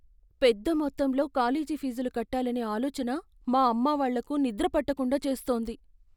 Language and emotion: Telugu, fearful